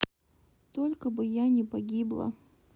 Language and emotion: Russian, sad